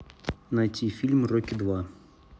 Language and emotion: Russian, neutral